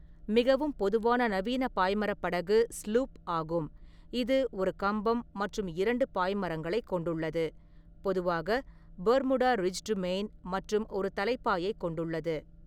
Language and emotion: Tamil, neutral